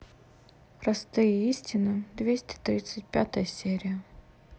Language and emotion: Russian, neutral